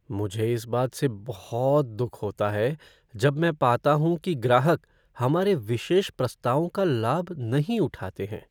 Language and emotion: Hindi, sad